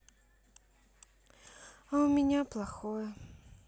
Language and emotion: Russian, sad